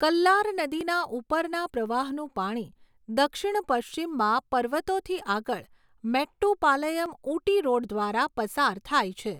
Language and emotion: Gujarati, neutral